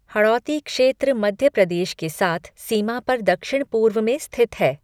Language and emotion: Hindi, neutral